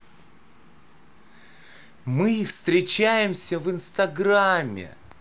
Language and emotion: Russian, positive